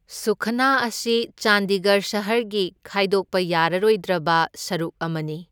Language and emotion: Manipuri, neutral